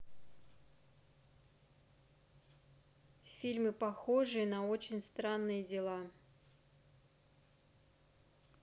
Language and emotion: Russian, neutral